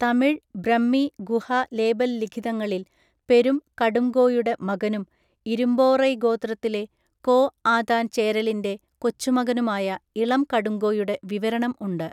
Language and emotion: Malayalam, neutral